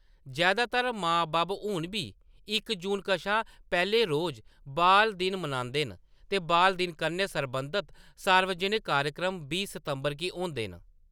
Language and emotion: Dogri, neutral